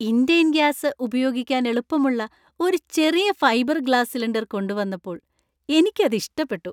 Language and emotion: Malayalam, happy